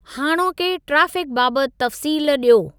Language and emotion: Sindhi, neutral